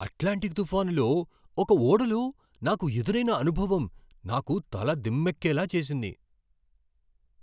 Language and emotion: Telugu, surprised